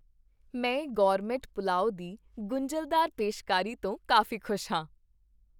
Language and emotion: Punjabi, happy